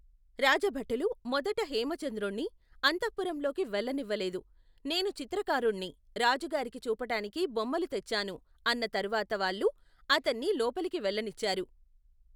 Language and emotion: Telugu, neutral